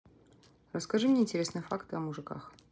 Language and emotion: Russian, neutral